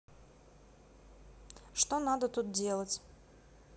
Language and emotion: Russian, neutral